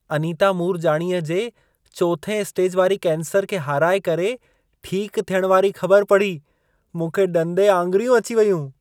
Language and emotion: Sindhi, surprised